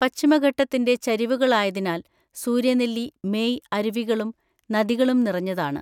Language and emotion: Malayalam, neutral